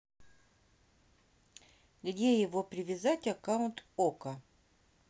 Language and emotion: Russian, neutral